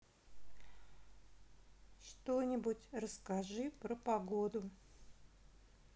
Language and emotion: Russian, sad